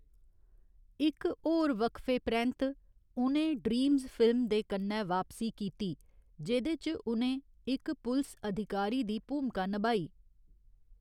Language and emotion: Dogri, neutral